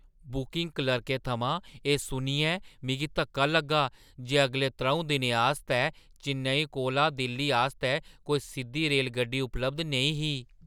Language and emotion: Dogri, surprised